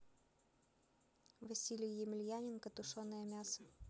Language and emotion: Russian, neutral